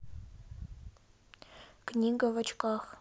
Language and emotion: Russian, sad